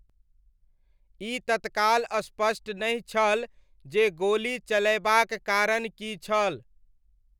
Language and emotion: Maithili, neutral